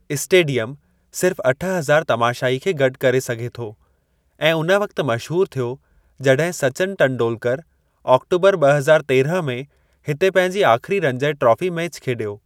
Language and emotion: Sindhi, neutral